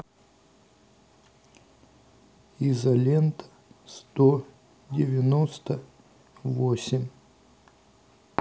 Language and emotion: Russian, neutral